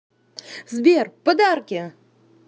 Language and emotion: Russian, positive